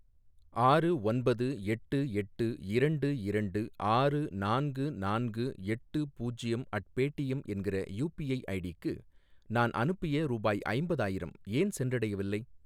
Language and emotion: Tamil, neutral